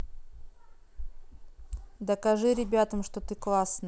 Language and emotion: Russian, neutral